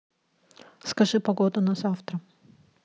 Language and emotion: Russian, neutral